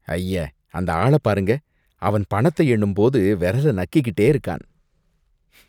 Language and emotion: Tamil, disgusted